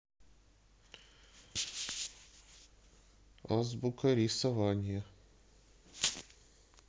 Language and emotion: Russian, neutral